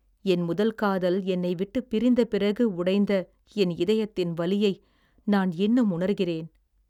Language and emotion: Tamil, sad